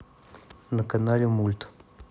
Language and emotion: Russian, neutral